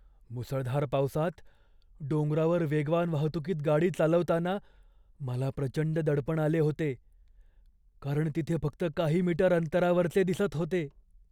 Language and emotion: Marathi, fearful